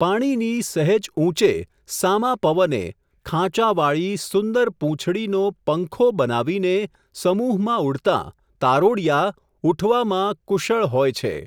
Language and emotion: Gujarati, neutral